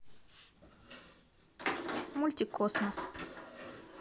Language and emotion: Russian, neutral